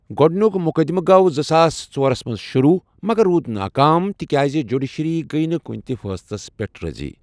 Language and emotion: Kashmiri, neutral